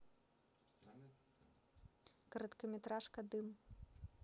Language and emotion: Russian, neutral